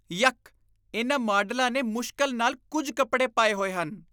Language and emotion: Punjabi, disgusted